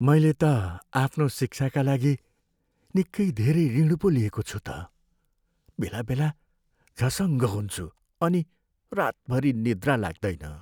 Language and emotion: Nepali, sad